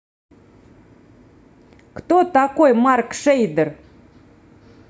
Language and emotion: Russian, neutral